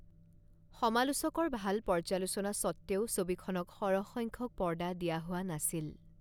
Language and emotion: Assamese, neutral